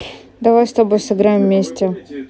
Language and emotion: Russian, neutral